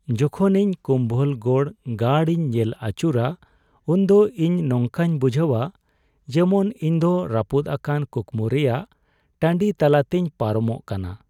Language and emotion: Santali, sad